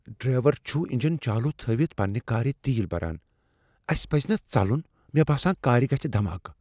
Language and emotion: Kashmiri, fearful